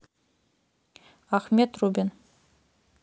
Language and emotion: Russian, neutral